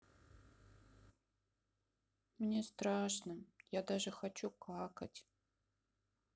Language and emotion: Russian, sad